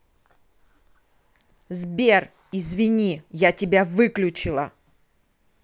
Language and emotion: Russian, angry